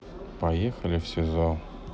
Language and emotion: Russian, sad